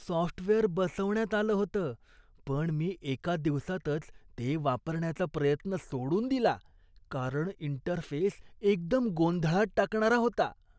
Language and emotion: Marathi, disgusted